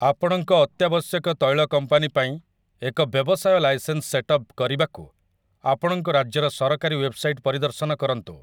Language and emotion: Odia, neutral